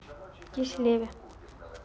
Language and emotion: Russian, neutral